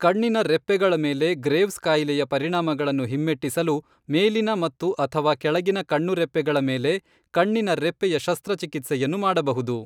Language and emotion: Kannada, neutral